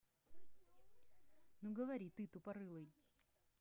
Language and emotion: Russian, angry